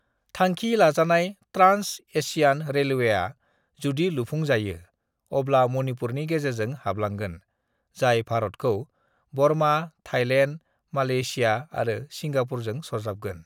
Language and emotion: Bodo, neutral